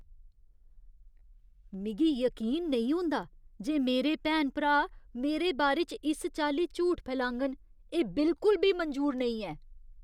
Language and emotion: Dogri, disgusted